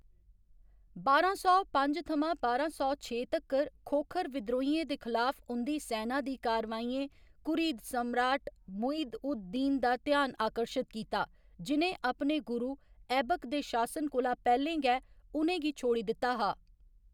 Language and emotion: Dogri, neutral